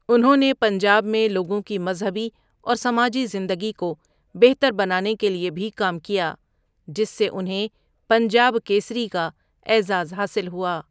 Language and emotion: Urdu, neutral